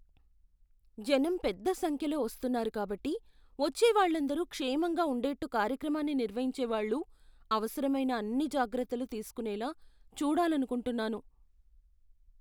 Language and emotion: Telugu, fearful